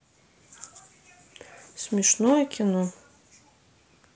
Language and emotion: Russian, neutral